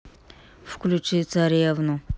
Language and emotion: Russian, neutral